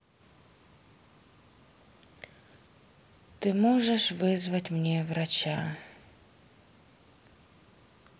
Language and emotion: Russian, sad